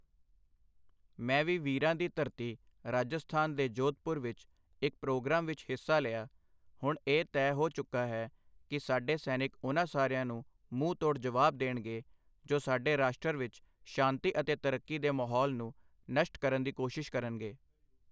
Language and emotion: Punjabi, neutral